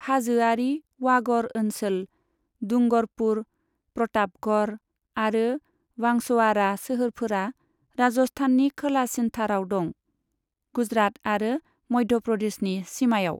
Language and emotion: Bodo, neutral